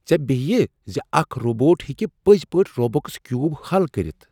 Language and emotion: Kashmiri, surprised